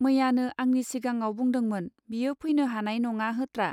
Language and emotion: Bodo, neutral